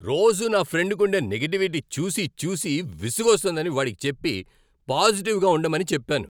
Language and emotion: Telugu, angry